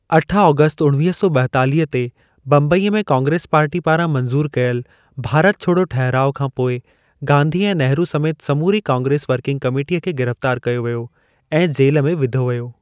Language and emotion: Sindhi, neutral